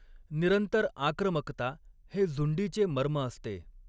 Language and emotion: Marathi, neutral